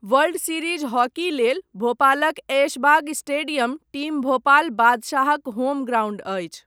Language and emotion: Maithili, neutral